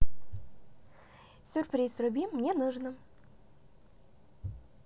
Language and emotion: Russian, positive